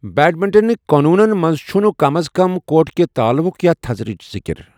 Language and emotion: Kashmiri, neutral